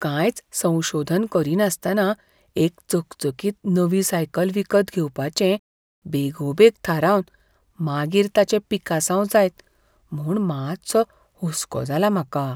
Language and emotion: Goan Konkani, fearful